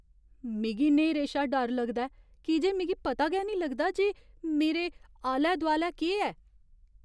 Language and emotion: Dogri, fearful